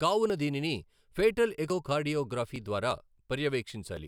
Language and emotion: Telugu, neutral